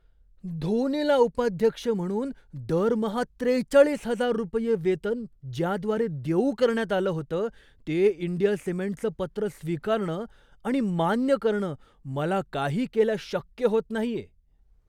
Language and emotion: Marathi, surprised